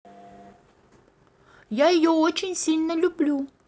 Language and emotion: Russian, positive